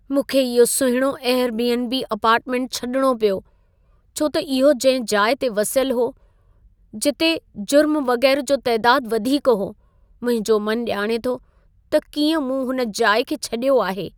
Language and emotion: Sindhi, sad